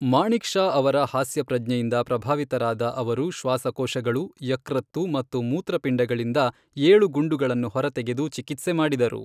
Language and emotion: Kannada, neutral